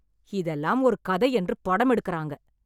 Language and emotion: Tamil, angry